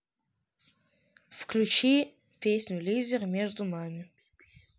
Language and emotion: Russian, neutral